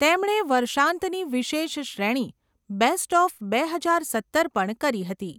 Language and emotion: Gujarati, neutral